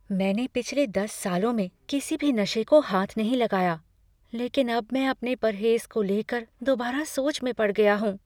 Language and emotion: Hindi, fearful